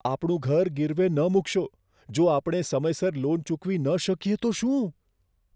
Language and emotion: Gujarati, fearful